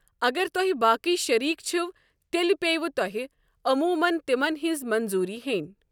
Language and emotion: Kashmiri, neutral